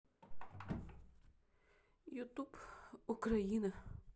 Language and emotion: Russian, neutral